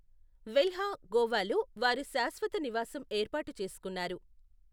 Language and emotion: Telugu, neutral